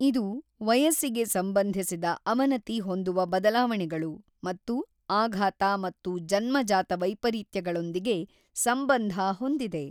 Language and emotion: Kannada, neutral